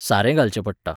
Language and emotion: Goan Konkani, neutral